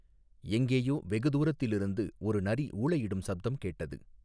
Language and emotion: Tamil, neutral